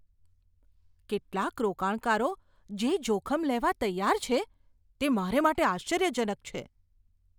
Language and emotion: Gujarati, surprised